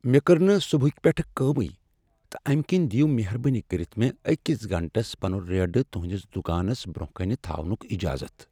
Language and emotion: Kashmiri, sad